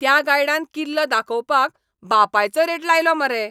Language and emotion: Goan Konkani, angry